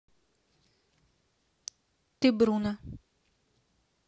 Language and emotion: Russian, neutral